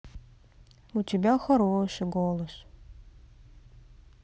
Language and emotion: Russian, sad